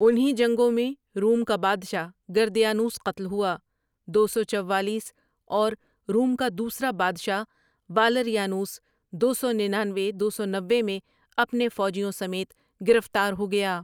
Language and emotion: Urdu, neutral